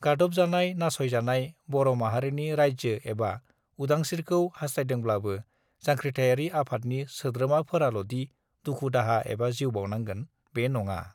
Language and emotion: Bodo, neutral